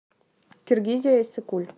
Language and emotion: Russian, neutral